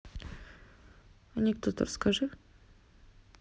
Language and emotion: Russian, neutral